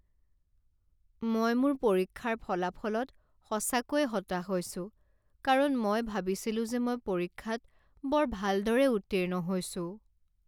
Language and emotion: Assamese, sad